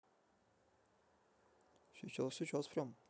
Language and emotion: Russian, neutral